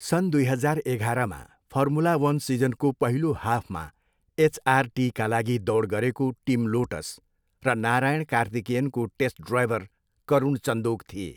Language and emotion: Nepali, neutral